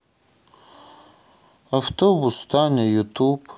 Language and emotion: Russian, sad